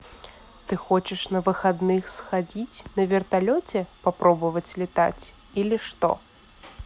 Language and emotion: Russian, neutral